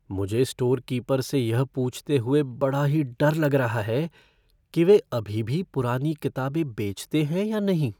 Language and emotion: Hindi, fearful